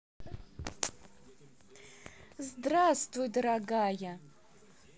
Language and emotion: Russian, positive